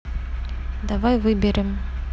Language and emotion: Russian, neutral